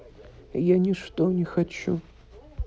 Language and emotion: Russian, sad